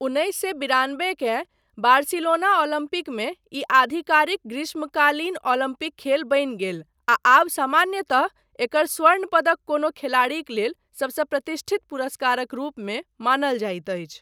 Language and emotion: Maithili, neutral